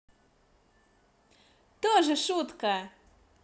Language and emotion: Russian, positive